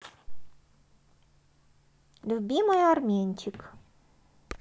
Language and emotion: Russian, positive